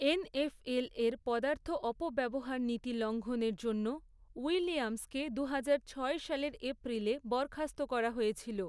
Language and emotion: Bengali, neutral